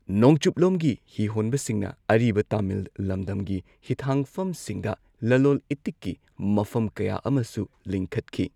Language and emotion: Manipuri, neutral